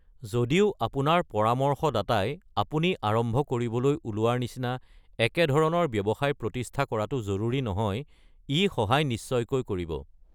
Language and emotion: Assamese, neutral